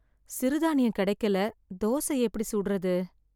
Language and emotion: Tamil, sad